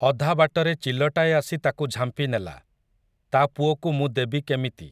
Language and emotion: Odia, neutral